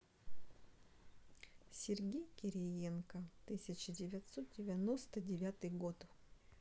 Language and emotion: Russian, neutral